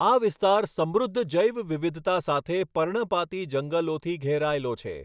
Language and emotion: Gujarati, neutral